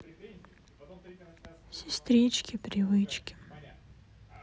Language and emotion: Russian, sad